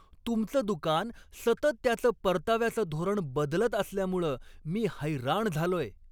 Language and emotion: Marathi, angry